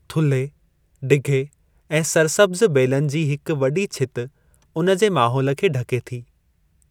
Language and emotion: Sindhi, neutral